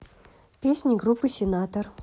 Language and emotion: Russian, neutral